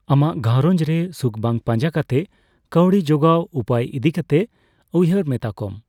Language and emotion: Santali, neutral